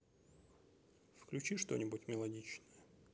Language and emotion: Russian, neutral